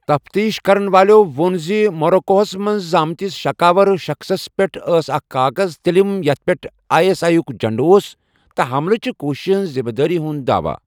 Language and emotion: Kashmiri, neutral